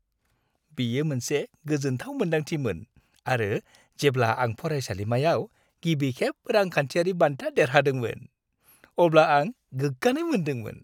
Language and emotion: Bodo, happy